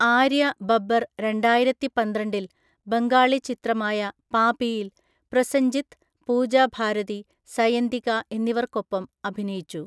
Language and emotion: Malayalam, neutral